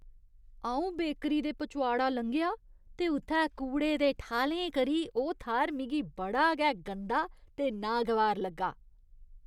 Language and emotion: Dogri, disgusted